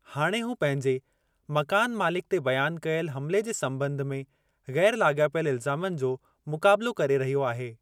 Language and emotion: Sindhi, neutral